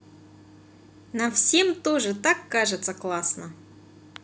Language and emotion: Russian, positive